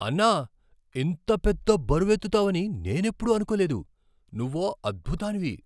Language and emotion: Telugu, surprised